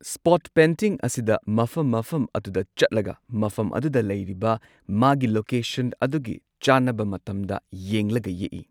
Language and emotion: Manipuri, neutral